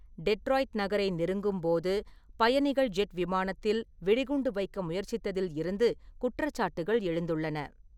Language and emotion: Tamil, neutral